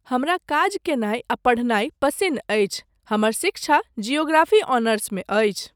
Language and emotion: Maithili, neutral